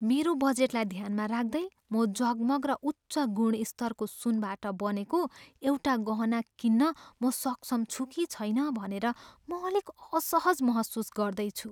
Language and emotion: Nepali, fearful